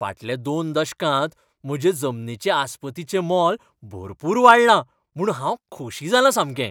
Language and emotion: Goan Konkani, happy